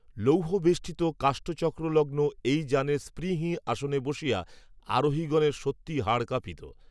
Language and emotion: Bengali, neutral